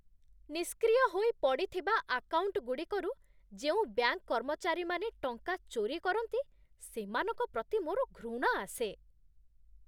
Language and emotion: Odia, disgusted